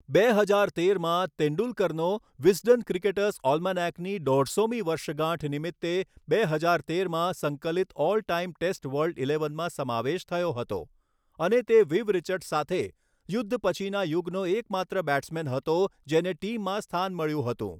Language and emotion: Gujarati, neutral